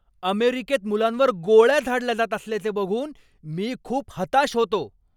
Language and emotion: Marathi, angry